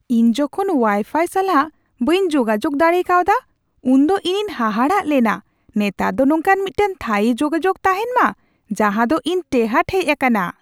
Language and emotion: Santali, surprised